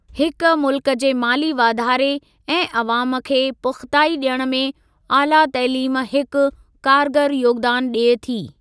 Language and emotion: Sindhi, neutral